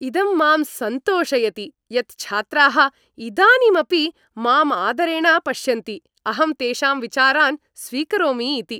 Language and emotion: Sanskrit, happy